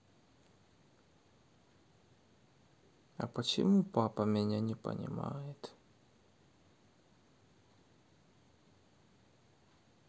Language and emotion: Russian, sad